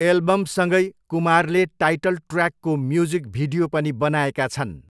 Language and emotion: Nepali, neutral